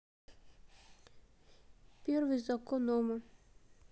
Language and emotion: Russian, sad